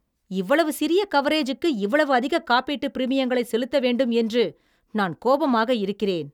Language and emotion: Tamil, angry